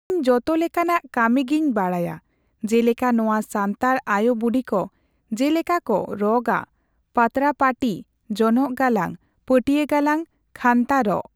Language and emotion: Santali, neutral